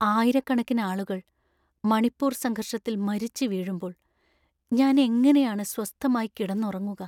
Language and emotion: Malayalam, sad